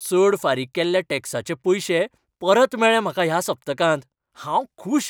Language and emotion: Goan Konkani, happy